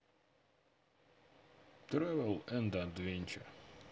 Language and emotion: Russian, neutral